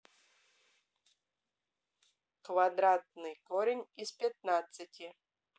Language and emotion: Russian, neutral